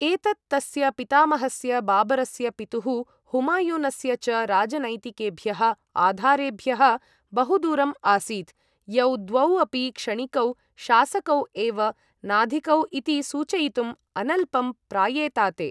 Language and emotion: Sanskrit, neutral